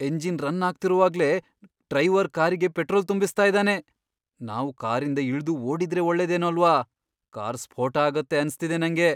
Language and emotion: Kannada, fearful